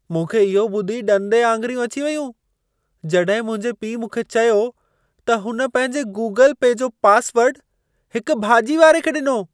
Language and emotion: Sindhi, surprised